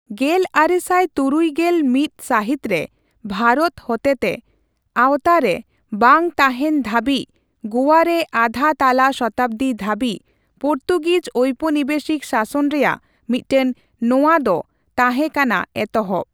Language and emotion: Santali, neutral